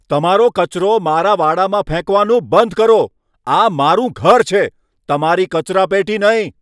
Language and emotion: Gujarati, angry